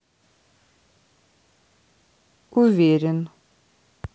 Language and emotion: Russian, neutral